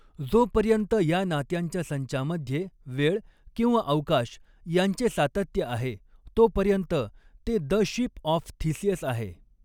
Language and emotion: Marathi, neutral